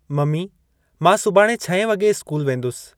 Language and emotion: Sindhi, neutral